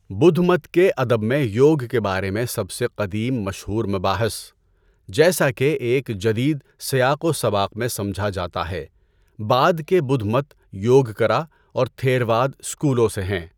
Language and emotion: Urdu, neutral